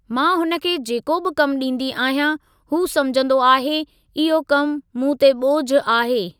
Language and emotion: Sindhi, neutral